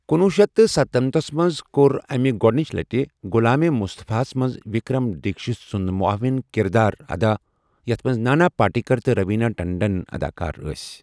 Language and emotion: Kashmiri, neutral